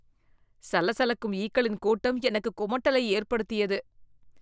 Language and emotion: Tamil, disgusted